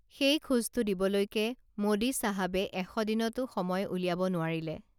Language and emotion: Assamese, neutral